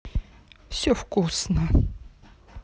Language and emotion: Russian, neutral